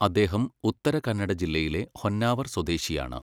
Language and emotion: Malayalam, neutral